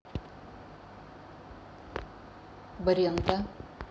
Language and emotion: Russian, neutral